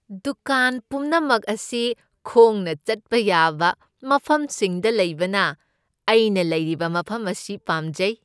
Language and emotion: Manipuri, happy